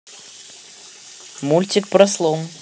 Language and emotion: Russian, neutral